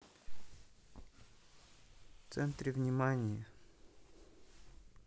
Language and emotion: Russian, neutral